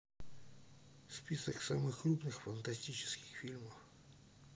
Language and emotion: Russian, sad